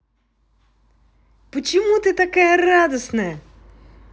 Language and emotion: Russian, positive